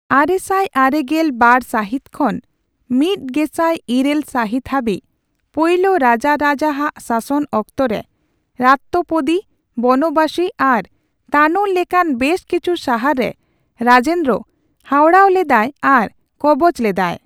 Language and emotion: Santali, neutral